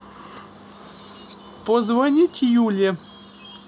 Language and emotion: Russian, neutral